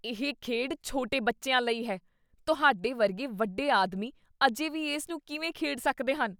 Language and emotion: Punjabi, disgusted